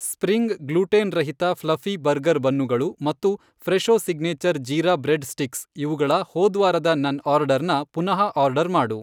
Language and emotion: Kannada, neutral